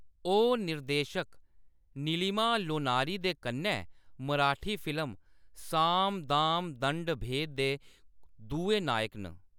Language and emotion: Dogri, neutral